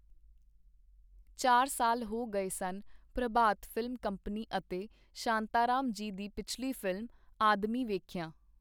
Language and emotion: Punjabi, neutral